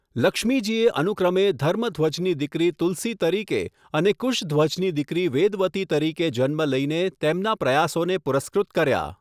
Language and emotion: Gujarati, neutral